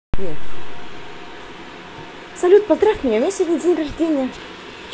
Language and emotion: Russian, positive